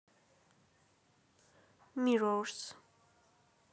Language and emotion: Russian, neutral